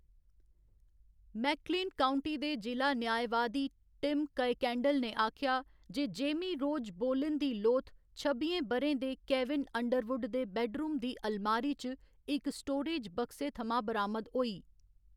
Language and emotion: Dogri, neutral